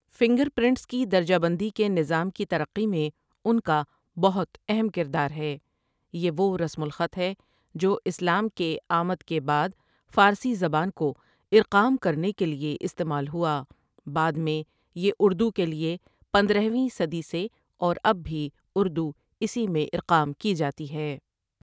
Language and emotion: Urdu, neutral